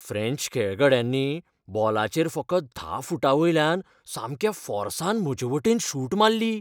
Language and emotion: Goan Konkani, fearful